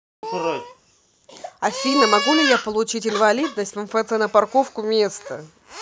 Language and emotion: Russian, neutral